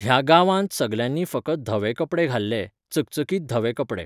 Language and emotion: Goan Konkani, neutral